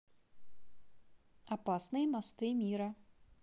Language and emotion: Russian, neutral